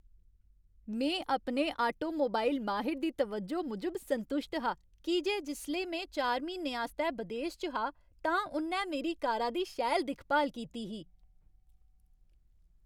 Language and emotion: Dogri, happy